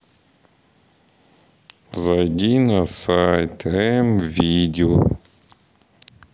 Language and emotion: Russian, sad